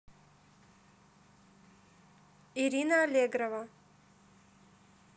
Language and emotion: Russian, neutral